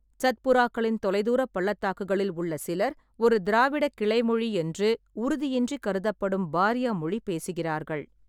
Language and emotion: Tamil, neutral